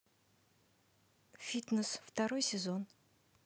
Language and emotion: Russian, neutral